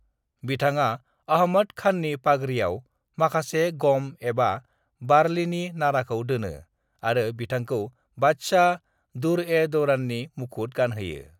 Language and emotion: Bodo, neutral